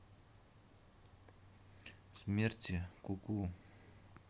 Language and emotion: Russian, sad